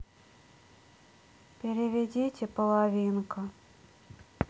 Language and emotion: Russian, sad